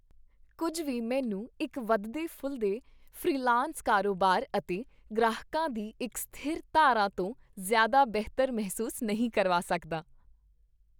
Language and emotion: Punjabi, happy